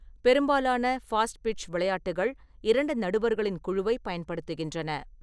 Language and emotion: Tamil, neutral